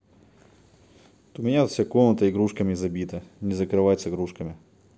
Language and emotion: Russian, neutral